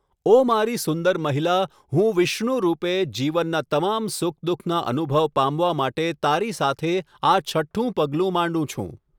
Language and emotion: Gujarati, neutral